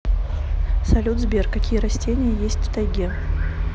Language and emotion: Russian, neutral